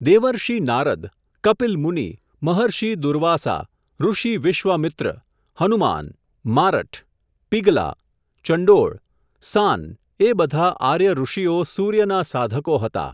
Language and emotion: Gujarati, neutral